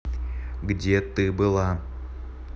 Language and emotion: Russian, angry